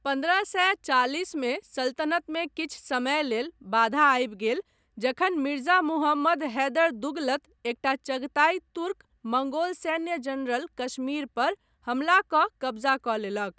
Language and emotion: Maithili, neutral